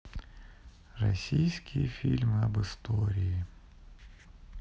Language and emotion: Russian, sad